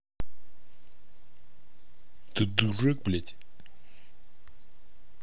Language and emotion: Russian, angry